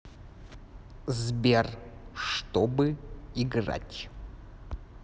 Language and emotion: Russian, neutral